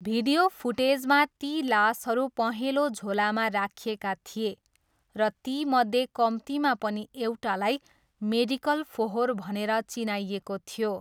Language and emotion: Nepali, neutral